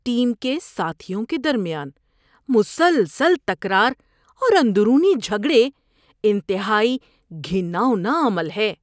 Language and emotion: Urdu, disgusted